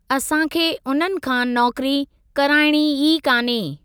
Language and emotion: Sindhi, neutral